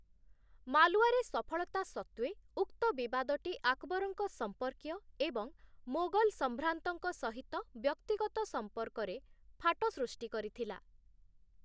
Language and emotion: Odia, neutral